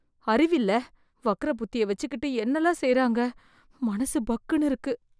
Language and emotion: Tamil, fearful